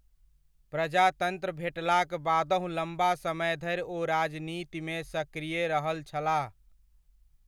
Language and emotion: Maithili, neutral